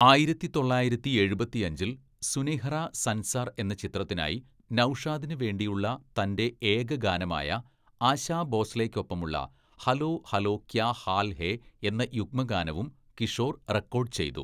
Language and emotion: Malayalam, neutral